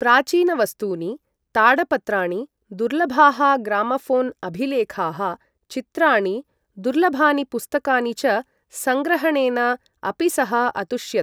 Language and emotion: Sanskrit, neutral